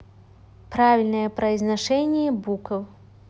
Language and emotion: Russian, neutral